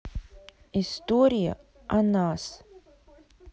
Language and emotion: Russian, neutral